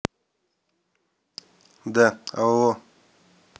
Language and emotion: Russian, neutral